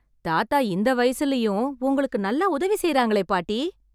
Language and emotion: Tamil, happy